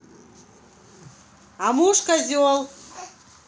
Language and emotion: Russian, angry